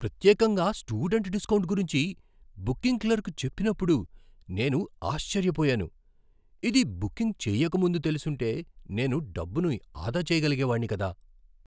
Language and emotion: Telugu, surprised